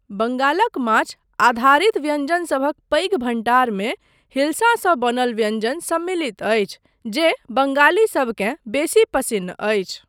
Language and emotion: Maithili, neutral